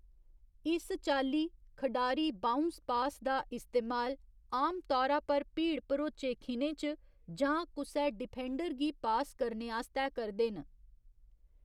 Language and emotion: Dogri, neutral